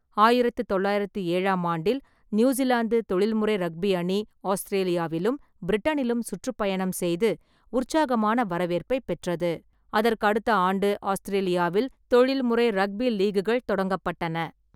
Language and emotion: Tamil, neutral